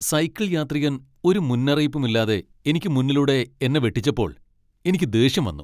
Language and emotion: Malayalam, angry